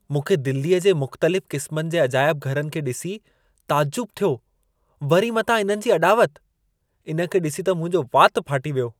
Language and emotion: Sindhi, surprised